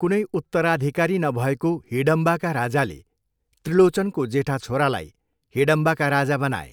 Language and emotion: Nepali, neutral